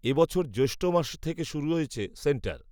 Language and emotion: Bengali, neutral